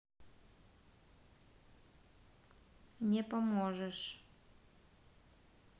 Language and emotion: Russian, neutral